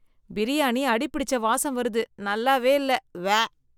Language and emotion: Tamil, disgusted